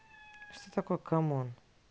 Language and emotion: Russian, neutral